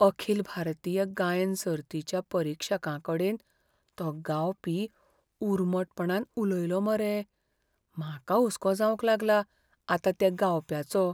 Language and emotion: Goan Konkani, fearful